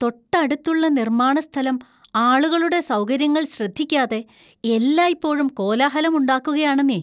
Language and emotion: Malayalam, disgusted